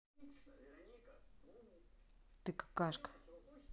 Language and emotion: Russian, neutral